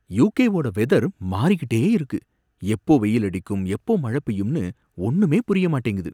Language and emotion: Tamil, surprised